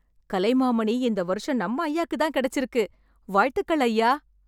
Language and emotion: Tamil, happy